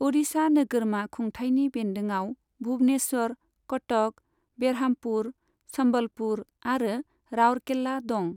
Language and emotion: Bodo, neutral